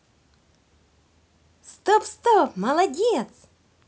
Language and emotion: Russian, positive